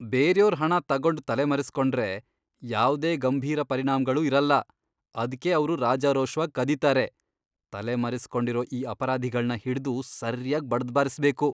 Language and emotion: Kannada, disgusted